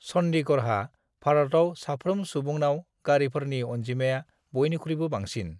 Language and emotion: Bodo, neutral